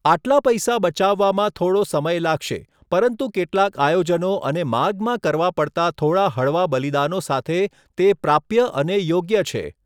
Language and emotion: Gujarati, neutral